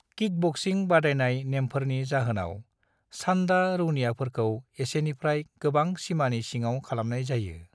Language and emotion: Bodo, neutral